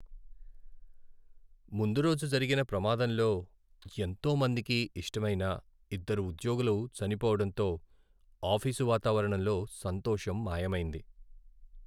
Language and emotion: Telugu, sad